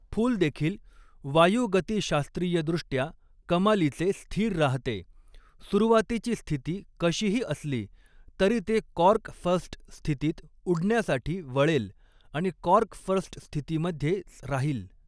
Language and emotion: Marathi, neutral